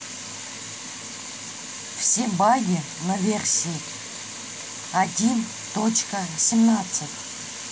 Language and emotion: Russian, neutral